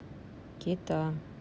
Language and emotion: Russian, neutral